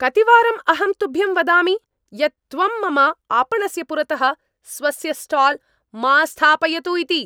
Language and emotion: Sanskrit, angry